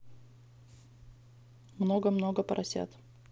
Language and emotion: Russian, neutral